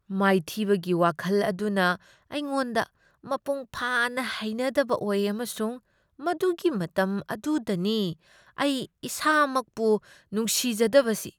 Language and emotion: Manipuri, disgusted